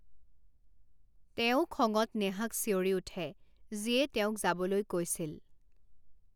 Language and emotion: Assamese, neutral